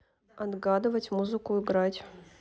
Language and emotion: Russian, neutral